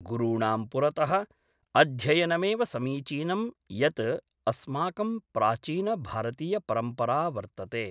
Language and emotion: Sanskrit, neutral